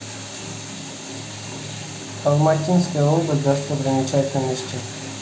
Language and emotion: Russian, neutral